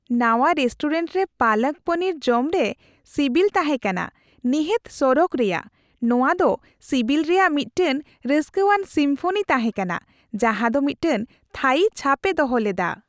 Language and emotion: Santali, happy